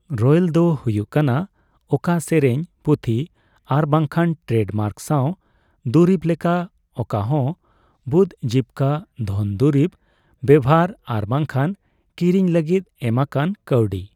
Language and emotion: Santali, neutral